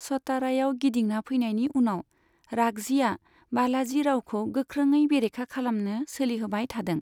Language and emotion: Bodo, neutral